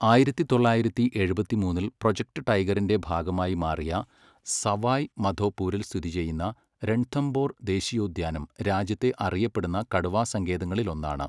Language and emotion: Malayalam, neutral